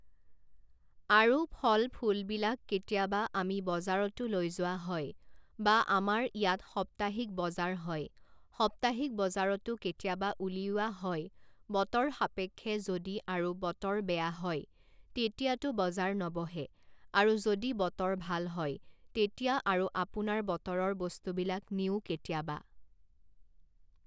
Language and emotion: Assamese, neutral